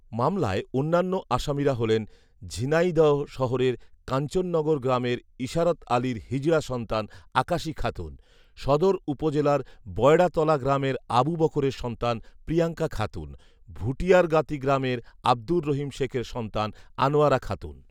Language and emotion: Bengali, neutral